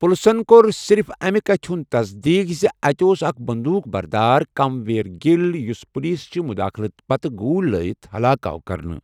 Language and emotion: Kashmiri, neutral